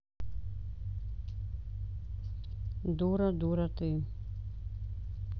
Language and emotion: Russian, neutral